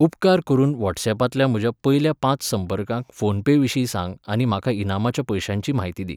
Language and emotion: Goan Konkani, neutral